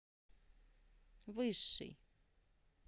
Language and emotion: Russian, neutral